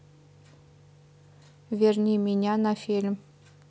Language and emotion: Russian, neutral